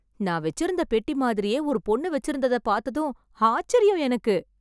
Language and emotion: Tamil, surprised